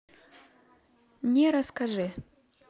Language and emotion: Russian, neutral